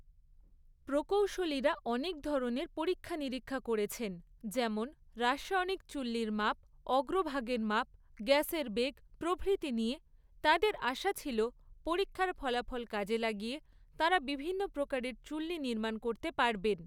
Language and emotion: Bengali, neutral